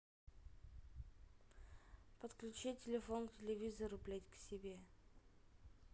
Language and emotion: Russian, neutral